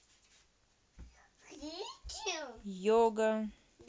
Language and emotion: Russian, neutral